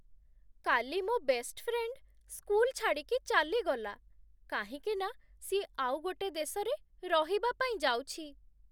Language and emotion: Odia, sad